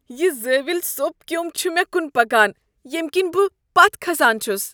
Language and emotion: Kashmiri, disgusted